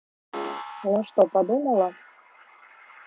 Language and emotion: Russian, neutral